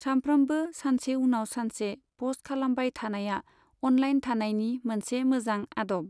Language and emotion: Bodo, neutral